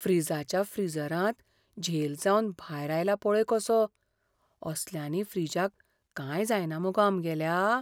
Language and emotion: Goan Konkani, fearful